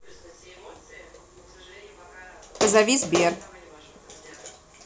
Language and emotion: Russian, neutral